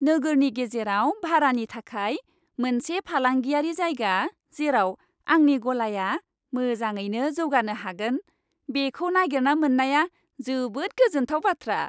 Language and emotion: Bodo, happy